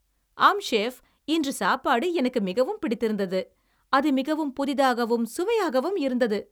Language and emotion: Tamil, happy